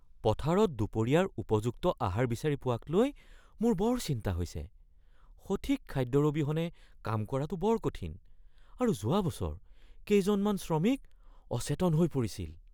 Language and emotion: Assamese, fearful